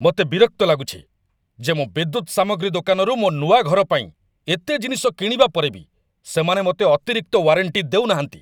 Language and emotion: Odia, angry